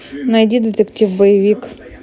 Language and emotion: Russian, neutral